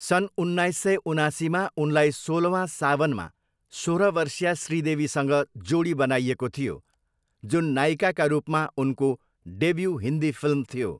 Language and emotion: Nepali, neutral